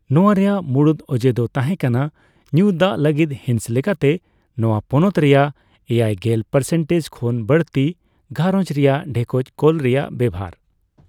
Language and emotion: Santali, neutral